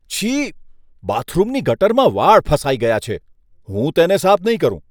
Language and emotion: Gujarati, disgusted